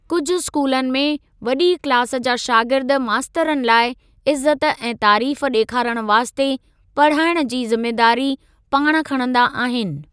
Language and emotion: Sindhi, neutral